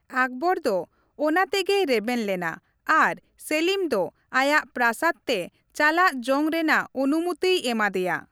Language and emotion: Santali, neutral